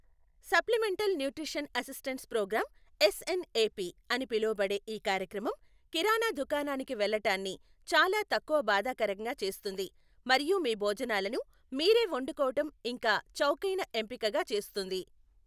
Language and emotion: Telugu, neutral